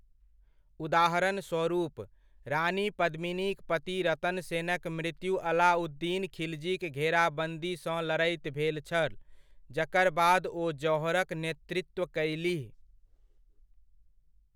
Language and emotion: Maithili, neutral